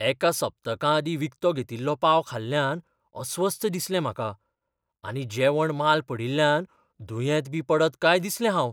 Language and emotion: Goan Konkani, fearful